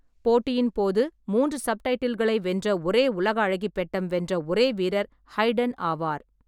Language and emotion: Tamil, neutral